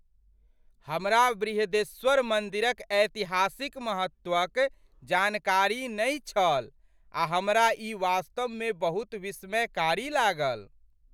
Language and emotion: Maithili, surprised